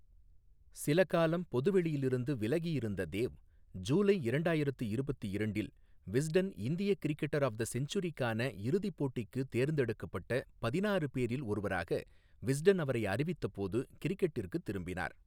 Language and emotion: Tamil, neutral